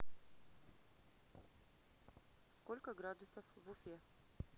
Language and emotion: Russian, neutral